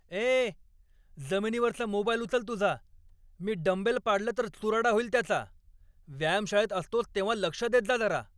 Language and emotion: Marathi, angry